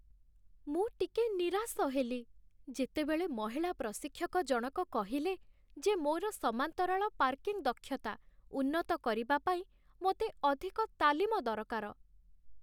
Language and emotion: Odia, sad